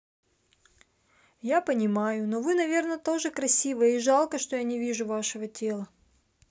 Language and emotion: Russian, sad